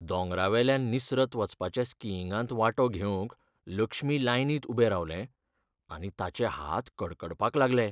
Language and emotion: Goan Konkani, fearful